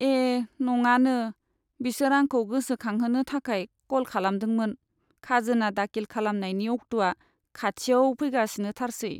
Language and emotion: Bodo, sad